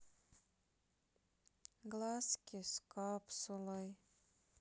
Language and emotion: Russian, sad